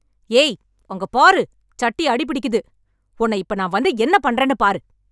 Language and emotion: Tamil, angry